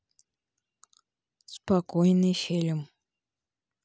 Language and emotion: Russian, neutral